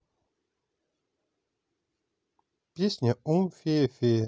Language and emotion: Russian, neutral